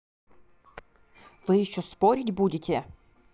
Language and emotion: Russian, angry